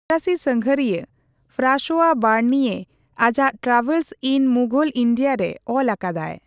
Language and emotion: Santali, neutral